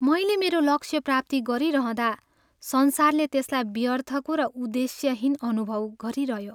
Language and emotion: Nepali, sad